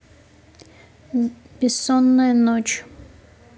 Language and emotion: Russian, neutral